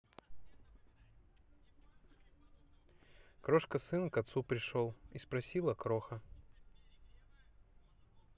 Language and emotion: Russian, neutral